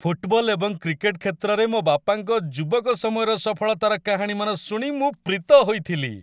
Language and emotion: Odia, happy